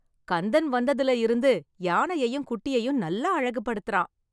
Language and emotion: Tamil, happy